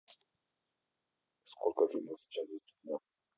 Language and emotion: Russian, neutral